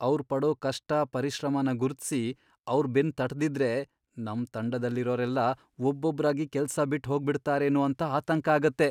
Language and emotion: Kannada, fearful